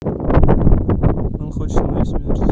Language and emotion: Russian, neutral